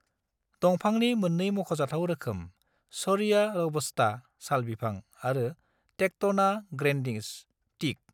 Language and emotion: Bodo, neutral